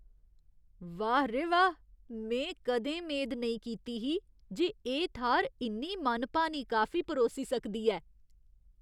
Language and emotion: Dogri, surprised